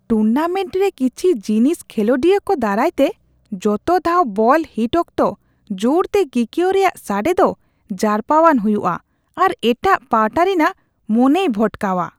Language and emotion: Santali, disgusted